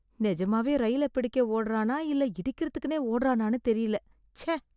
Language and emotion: Tamil, disgusted